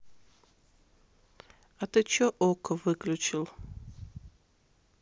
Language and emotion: Russian, neutral